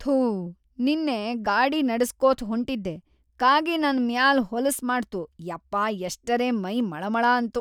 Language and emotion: Kannada, disgusted